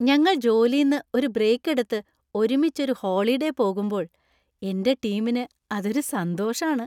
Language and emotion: Malayalam, happy